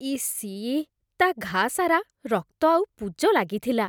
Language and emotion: Odia, disgusted